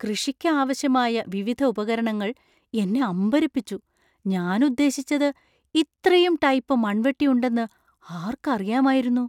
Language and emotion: Malayalam, surprised